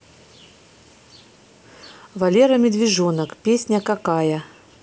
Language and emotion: Russian, neutral